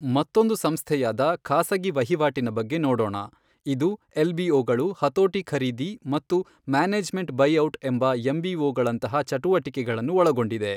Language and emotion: Kannada, neutral